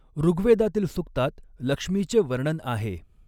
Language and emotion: Marathi, neutral